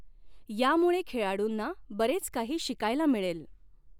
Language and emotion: Marathi, neutral